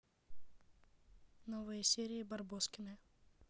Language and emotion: Russian, neutral